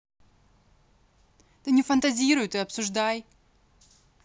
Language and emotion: Russian, angry